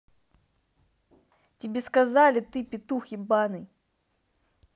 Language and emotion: Russian, angry